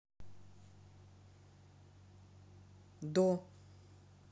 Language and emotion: Russian, neutral